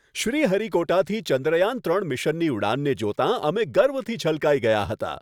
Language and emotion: Gujarati, happy